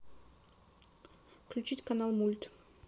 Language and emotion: Russian, neutral